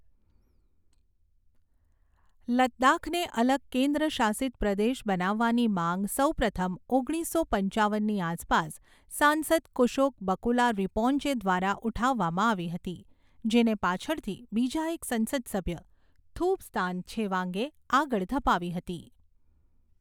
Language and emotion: Gujarati, neutral